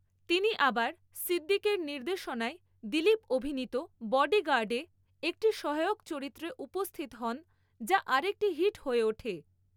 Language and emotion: Bengali, neutral